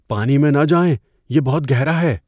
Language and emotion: Urdu, fearful